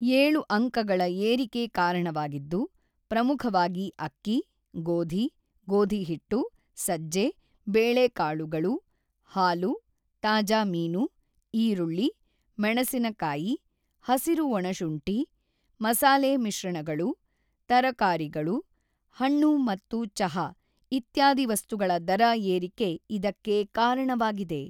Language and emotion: Kannada, neutral